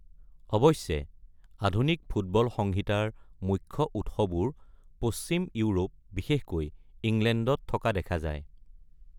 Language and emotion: Assamese, neutral